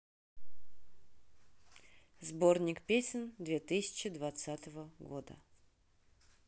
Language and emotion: Russian, neutral